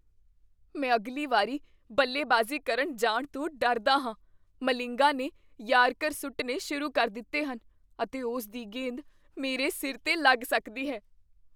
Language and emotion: Punjabi, fearful